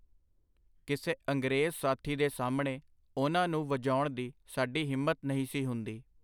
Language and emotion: Punjabi, neutral